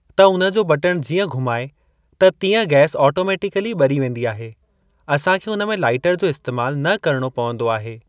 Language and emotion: Sindhi, neutral